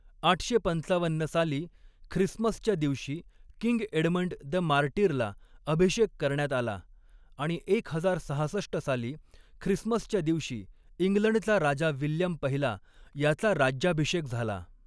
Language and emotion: Marathi, neutral